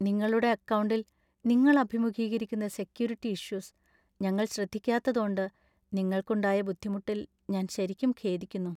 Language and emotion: Malayalam, sad